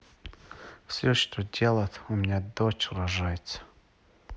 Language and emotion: Russian, neutral